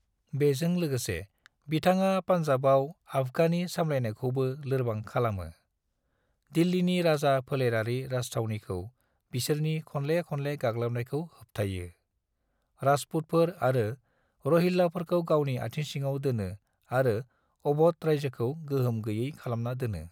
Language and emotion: Bodo, neutral